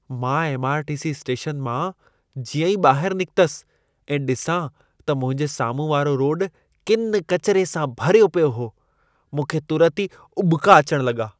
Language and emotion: Sindhi, disgusted